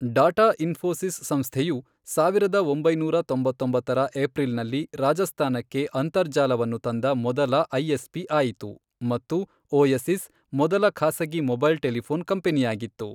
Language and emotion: Kannada, neutral